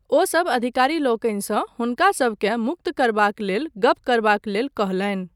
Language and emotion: Maithili, neutral